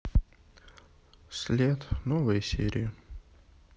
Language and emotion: Russian, sad